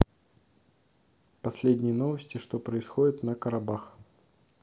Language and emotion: Russian, neutral